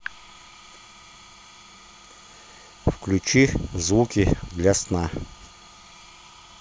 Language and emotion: Russian, neutral